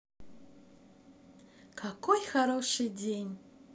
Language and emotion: Russian, positive